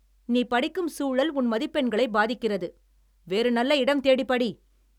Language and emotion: Tamil, angry